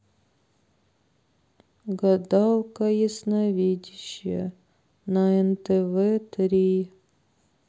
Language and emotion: Russian, sad